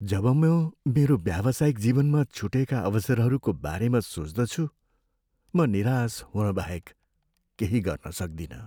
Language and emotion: Nepali, sad